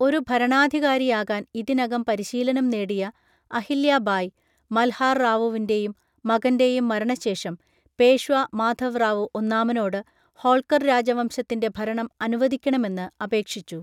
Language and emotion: Malayalam, neutral